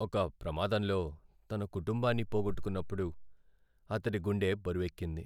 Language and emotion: Telugu, sad